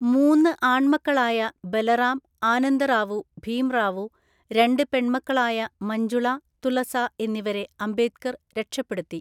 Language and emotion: Malayalam, neutral